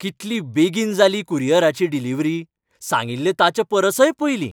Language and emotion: Goan Konkani, happy